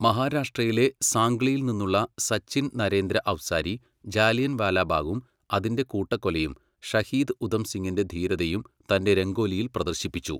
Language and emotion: Malayalam, neutral